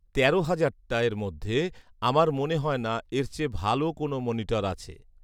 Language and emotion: Bengali, neutral